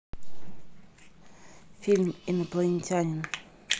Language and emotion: Russian, neutral